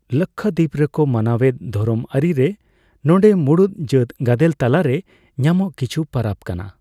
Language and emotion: Santali, neutral